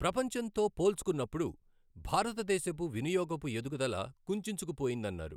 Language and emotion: Telugu, neutral